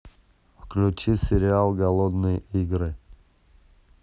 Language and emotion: Russian, neutral